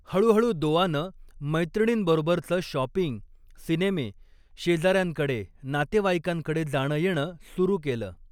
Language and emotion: Marathi, neutral